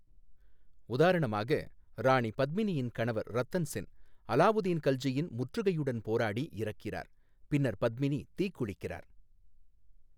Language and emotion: Tamil, neutral